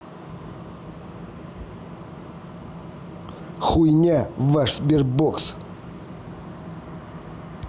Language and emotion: Russian, angry